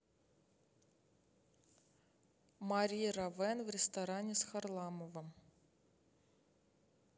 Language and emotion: Russian, neutral